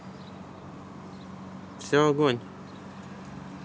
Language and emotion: Russian, neutral